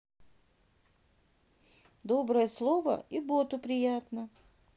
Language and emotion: Russian, neutral